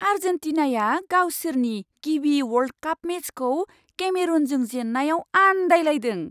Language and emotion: Bodo, surprised